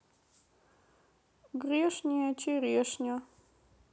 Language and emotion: Russian, sad